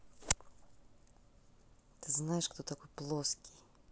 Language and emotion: Russian, neutral